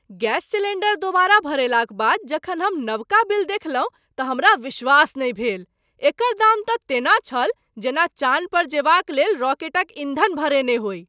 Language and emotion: Maithili, surprised